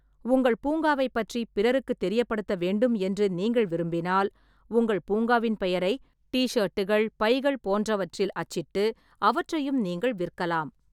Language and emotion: Tamil, neutral